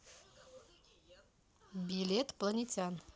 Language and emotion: Russian, neutral